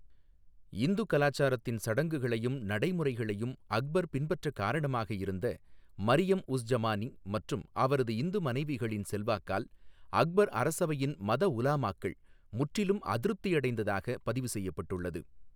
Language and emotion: Tamil, neutral